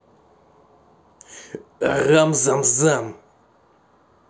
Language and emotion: Russian, angry